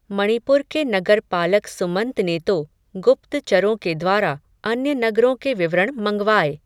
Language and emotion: Hindi, neutral